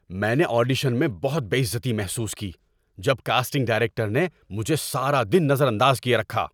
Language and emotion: Urdu, angry